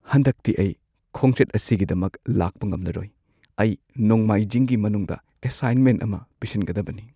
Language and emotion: Manipuri, sad